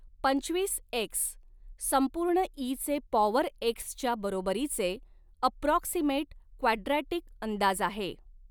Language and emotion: Marathi, neutral